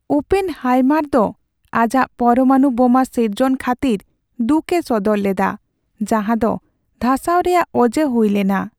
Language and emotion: Santali, sad